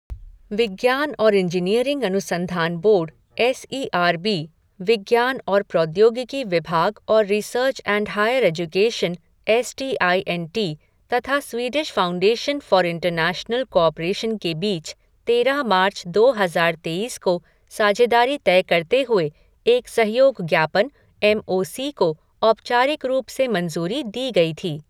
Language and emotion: Hindi, neutral